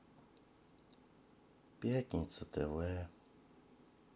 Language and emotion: Russian, sad